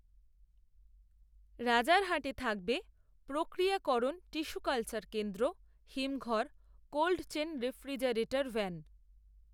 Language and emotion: Bengali, neutral